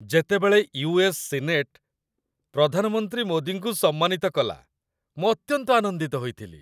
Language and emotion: Odia, happy